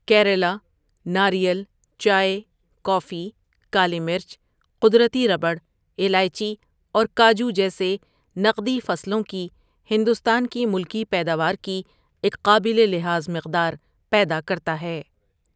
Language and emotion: Urdu, neutral